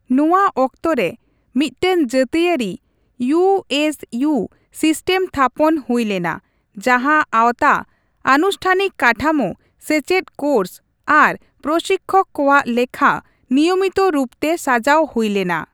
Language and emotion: Santali, neutral